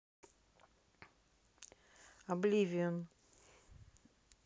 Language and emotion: Russian, neutral